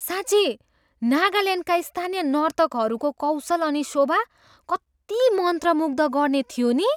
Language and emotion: Nepali, surprised